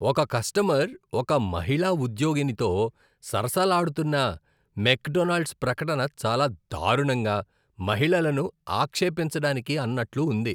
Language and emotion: Telugu, disgusted